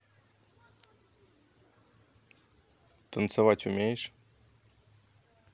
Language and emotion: Russian, neutral